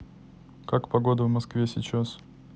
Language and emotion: Russian, neutral